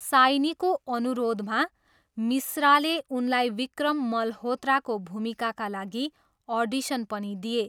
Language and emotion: Nepali, neutral